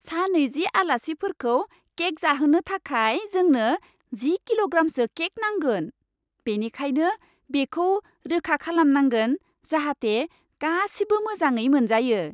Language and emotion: Bodo, happy